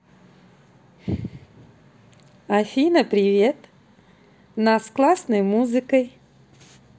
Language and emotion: Russian, positive